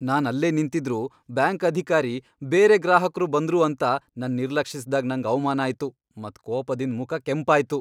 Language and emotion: Kannada, angry